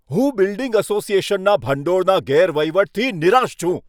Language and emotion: Gujarati, angry